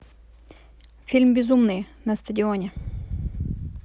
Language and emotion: Russian, neutral